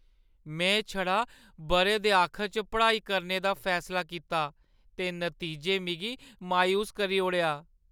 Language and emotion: Dogri, sad